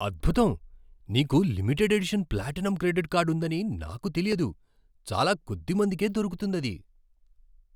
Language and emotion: Telugu, surprised